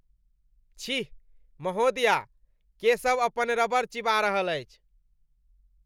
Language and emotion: Maithili, disgusted